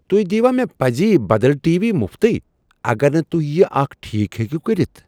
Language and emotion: Kashmiri, surprised